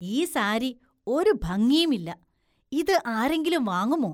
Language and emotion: Malayalam, disgusted